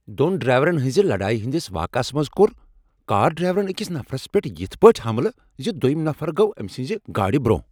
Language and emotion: Kashmiri, angry